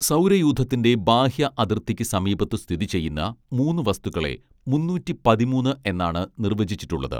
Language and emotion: Malayalam, neutral